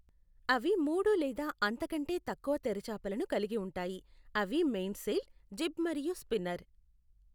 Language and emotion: Telugu, neutral